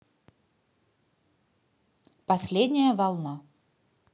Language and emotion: Russian, neutral